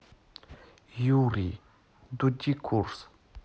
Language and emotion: Russian, sad